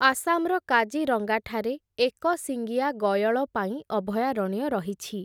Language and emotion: Odia, neutral